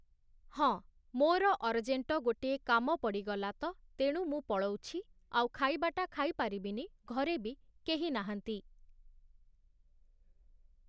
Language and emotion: Odia, neutral